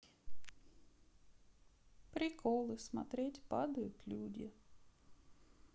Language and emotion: Russian, sad